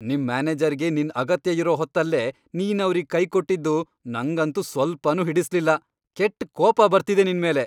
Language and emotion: Kannada, angry